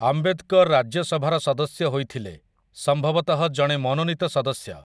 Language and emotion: Odia, neutral